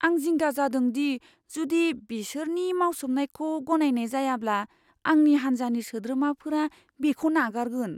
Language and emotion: Bodo, fearful